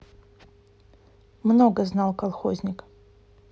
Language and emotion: Russian, neutral